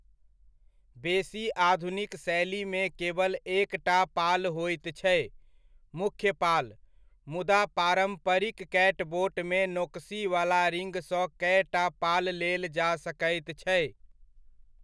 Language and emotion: Maithili, neutral